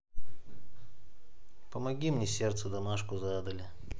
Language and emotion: Russian, neutral